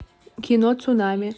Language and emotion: Russian, neutral